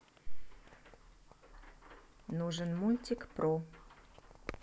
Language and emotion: Russian, neutral